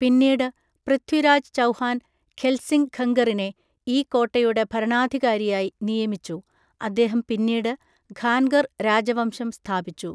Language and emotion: Malayalam, neutral